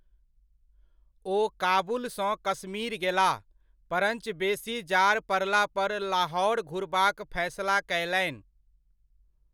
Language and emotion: Maithili, neutral